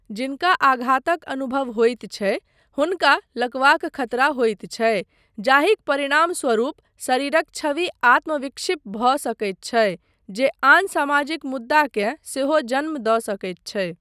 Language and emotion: Maithili, neutral